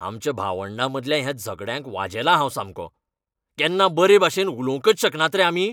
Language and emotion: Goan Konkani, angry